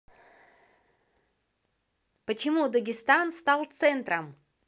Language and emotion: Russian, positive